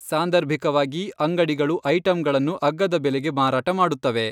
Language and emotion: Kannada, neutral